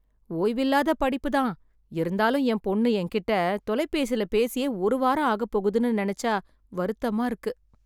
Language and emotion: Tamil, sad